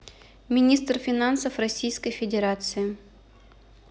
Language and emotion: Russian, neutral